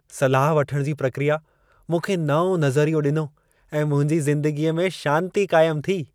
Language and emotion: Sindhi, happy